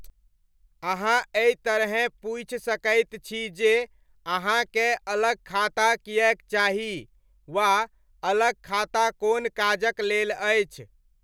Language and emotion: Maithili, neutral